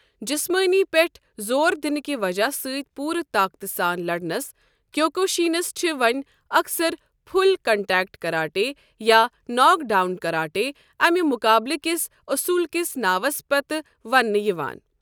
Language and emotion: Kashmiri, neutral